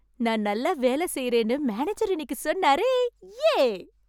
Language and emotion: Tamil, happy